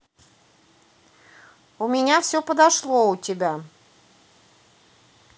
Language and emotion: Russian, neutral